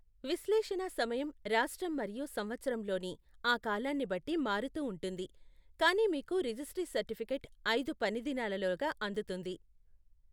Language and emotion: Telugu, neutral